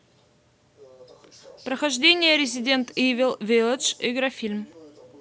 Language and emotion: Russian, neutral